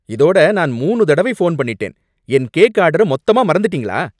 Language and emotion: Tamil, angry